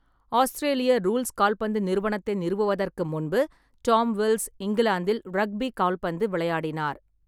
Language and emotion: Tamil, neutral